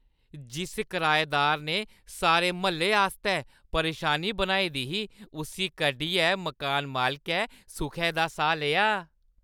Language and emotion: Dogri, happy